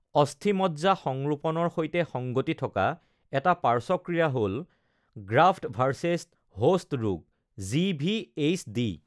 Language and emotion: Assamese, neutral